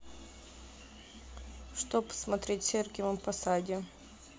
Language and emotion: Russian, neutral